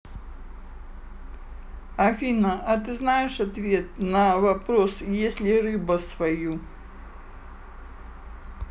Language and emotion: Russian, neutral